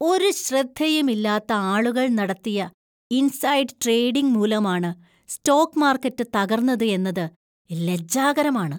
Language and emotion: Malayalam, disgusted